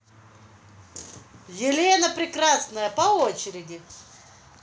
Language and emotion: Russian, positive